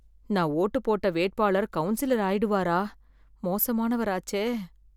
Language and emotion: Tamil, fearful